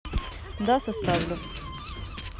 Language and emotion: Russian, neutral